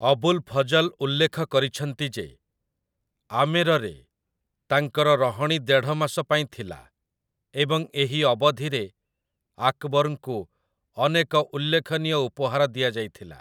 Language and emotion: Odia, neutral